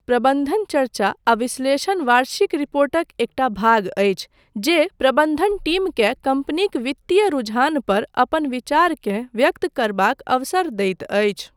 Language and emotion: Maithili, neutral